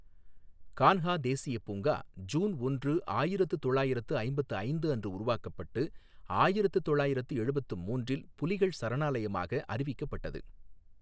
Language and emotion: Tamil, neutral